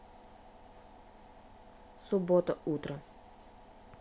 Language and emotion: Russian, neutral